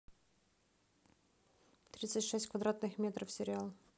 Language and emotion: Russian, neutral